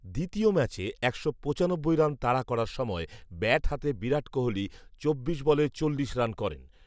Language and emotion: Bengali, neutral